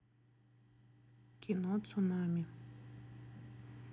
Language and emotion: Russian, neutral